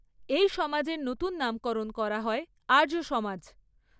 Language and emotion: Bengali, neutral